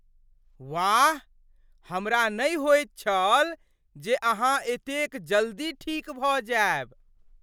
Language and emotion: Maithili, surprised